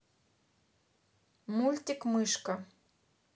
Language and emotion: Russian, neutral